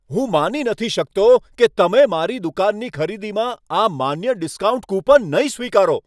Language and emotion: Gujarati, angry